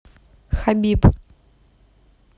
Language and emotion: Russian, neutral